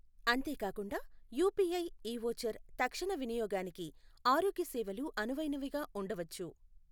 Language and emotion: Telugu, neutral